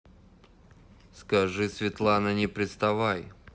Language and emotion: Russian, angry